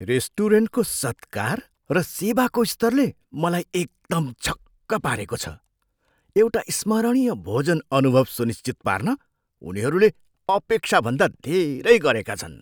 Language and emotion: Nepali, surprised